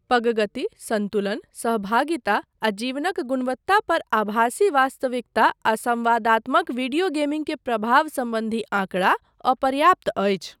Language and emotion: Maithili, neutral